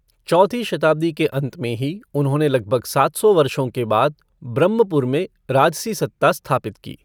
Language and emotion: Hindi, neutral